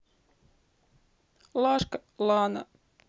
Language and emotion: Russian, sad